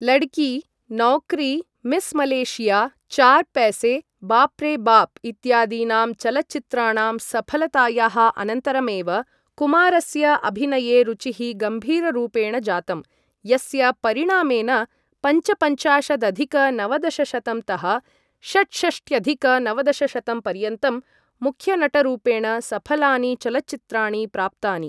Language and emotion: Sanskrit, neutral